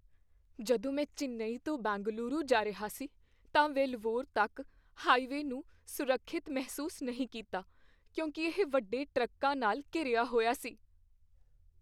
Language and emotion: Punjabi, fearful